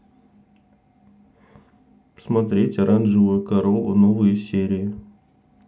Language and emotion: Russian, neutral